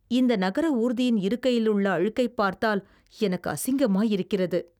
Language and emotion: Tamil, disgusted